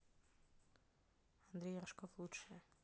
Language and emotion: Russian, neutral